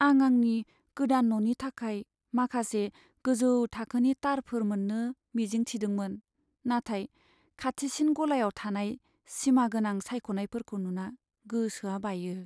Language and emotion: Bodo, sad